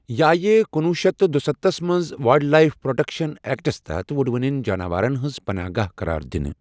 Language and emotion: Kashmiri, neutral